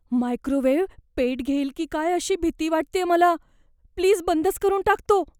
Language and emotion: Marathi, fearful